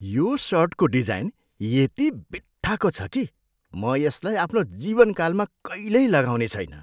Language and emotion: Nepali, disgusted